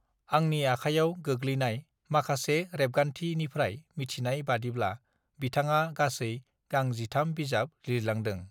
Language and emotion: Bodo, neutral